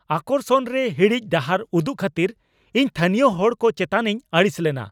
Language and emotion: Santali, angry